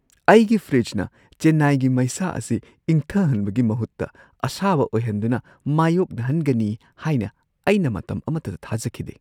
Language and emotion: Manipuri, surprised